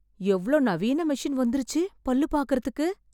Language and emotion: Tamil, surprised